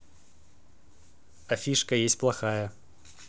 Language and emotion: Russian, neutral